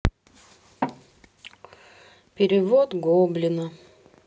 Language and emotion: Russian, sad